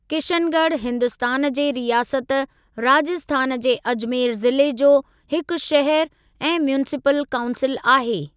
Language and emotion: Sindhi, neutral